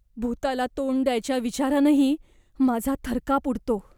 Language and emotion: Marathi, fearful